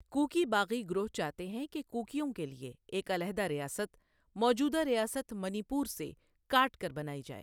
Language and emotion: Urdu, neutral